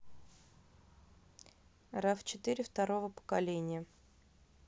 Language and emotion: Russian, neutral